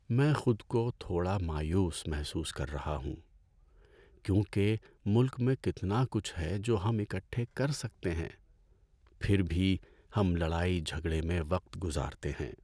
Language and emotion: Urdu, sad